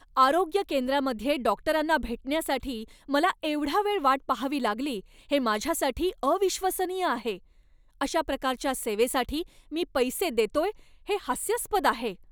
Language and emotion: Marathi, angry